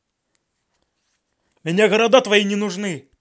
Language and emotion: Russian, angry